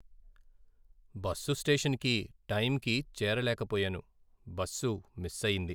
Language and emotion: Telugu, sad